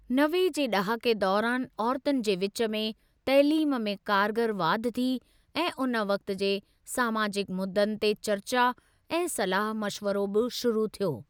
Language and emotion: Sindhi, neutral